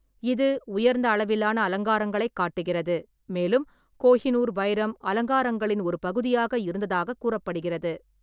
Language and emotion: Tamil, neutral